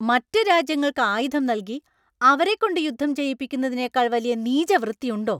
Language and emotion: Malayalam, angry